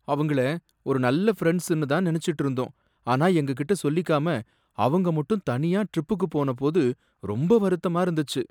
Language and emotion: Tamil, sad